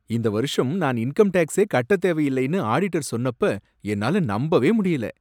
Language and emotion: Tamil, surprised